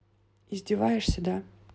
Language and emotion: Russian, neutral